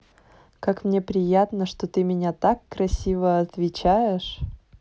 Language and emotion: Russian, positive